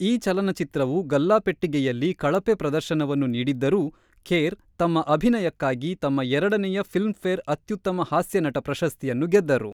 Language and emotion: Kannada, neutral